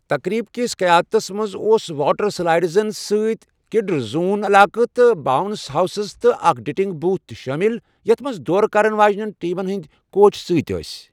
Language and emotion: Kashmiri, neutral